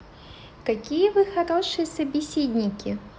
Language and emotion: Russian, positive